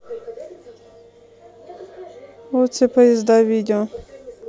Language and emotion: Russian, neutral